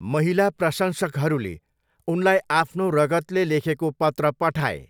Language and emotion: Nepali, neutral